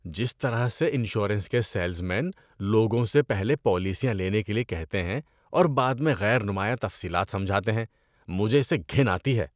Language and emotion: Urdu, disgusted